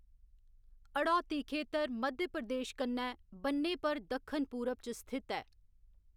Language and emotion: Dogri, neutral